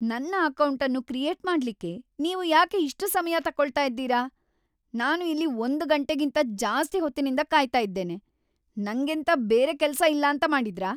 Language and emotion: Kannada, angry